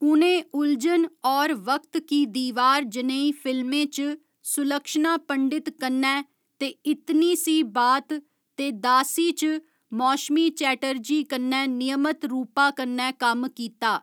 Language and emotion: Dogri, neutral